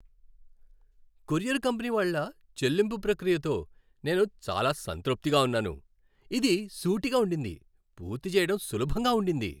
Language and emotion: Telugu, happy